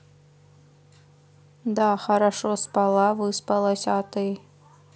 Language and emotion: Russian, neutral